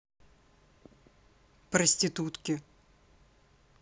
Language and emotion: Russian, neutral